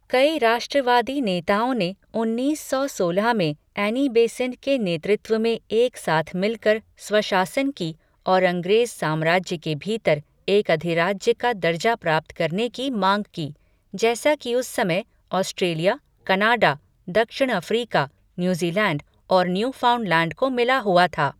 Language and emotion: Hindi, neutral